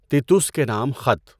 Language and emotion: Urdu, neutral